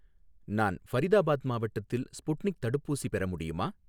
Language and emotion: Tamil, neutral